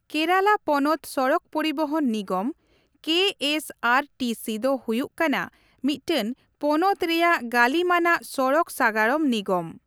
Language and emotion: Santali, neutral